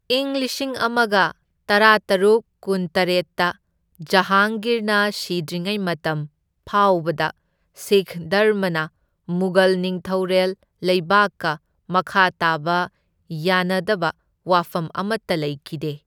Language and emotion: Manipuri, neutral